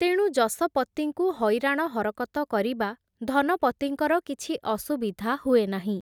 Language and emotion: Odia, neutral